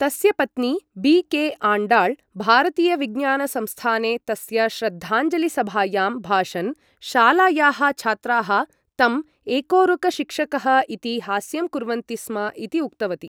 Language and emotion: Sanskrit, neutral